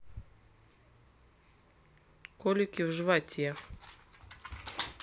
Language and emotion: Russian, neutral